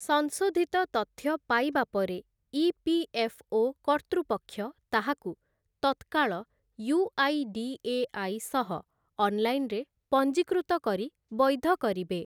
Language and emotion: Odia, neutral